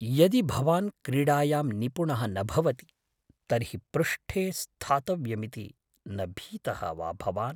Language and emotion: Sanskrit, fearful